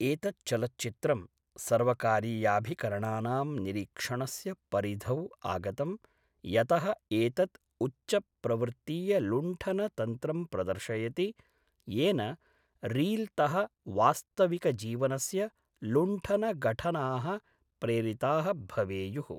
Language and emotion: Sanskrit, neutral